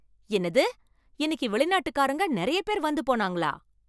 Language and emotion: Tamil, surprised